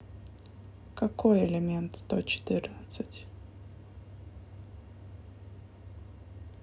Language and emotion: Russian, neutral